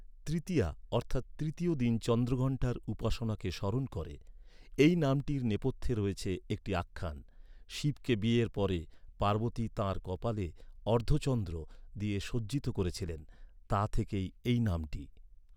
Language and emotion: Bengali, neutral